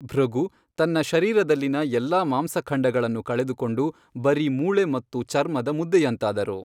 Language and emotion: Kannada, neutral